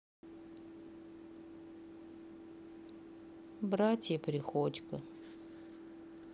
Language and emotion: Russian, sad